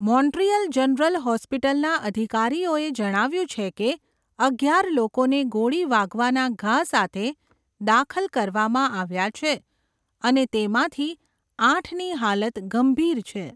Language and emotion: Gujarati, neutral